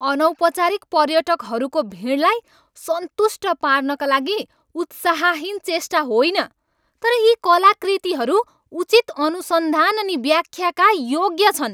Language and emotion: Nepali, angry